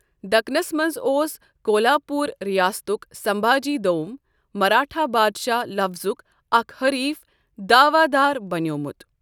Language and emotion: Kashmiri, neutral